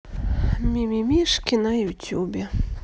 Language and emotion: Russian, sad